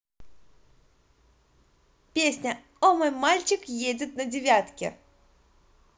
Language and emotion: Russian, positive